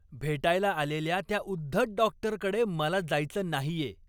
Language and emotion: Marathi, angry